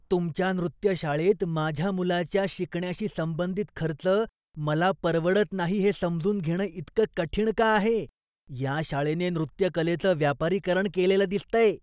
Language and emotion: Marathi, disgusted